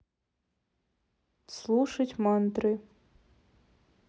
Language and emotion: Russian, neutral